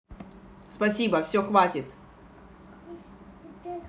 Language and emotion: Russian, angry